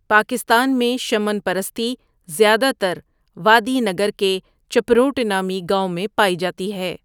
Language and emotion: Urdu, neutral